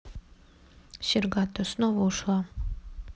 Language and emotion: Russian, sad